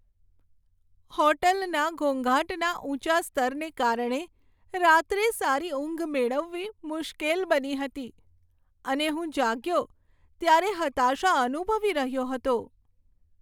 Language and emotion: Gujarati, sad